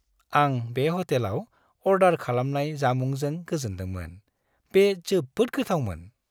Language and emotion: Bodo, happy